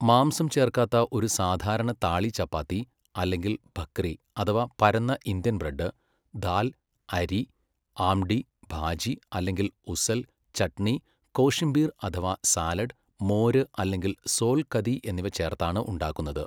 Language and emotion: Malayalam, neutral